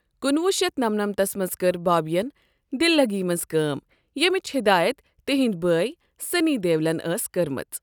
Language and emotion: Kashmiri, neutral